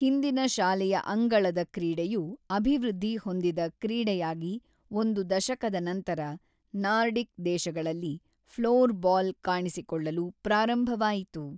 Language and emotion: Kannada, neutral